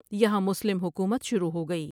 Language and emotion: Urdu, neutral